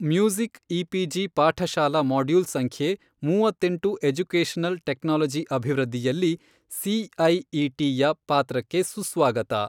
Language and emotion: Kannada, neutral